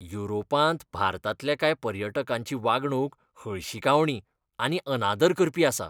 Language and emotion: Goan Konkani, disgusted